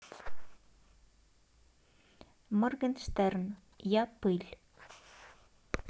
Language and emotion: Russian, neutral